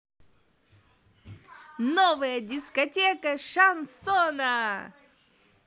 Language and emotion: Russian, positive